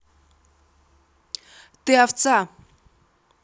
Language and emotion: Russian, angry